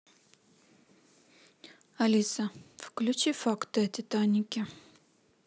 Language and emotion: Russian, neutral